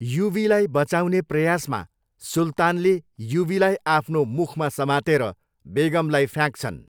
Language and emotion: Nepali, neutral